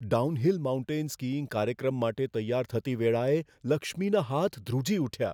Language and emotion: Gujarati, fearful